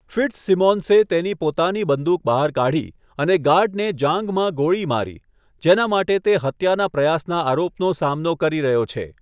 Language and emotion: Gujarati, neutral